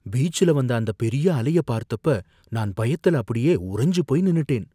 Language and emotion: Tamil, fearful